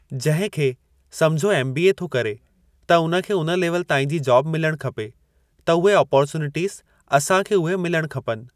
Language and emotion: Sindhi, neutral